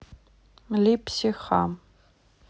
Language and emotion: Russian, neutral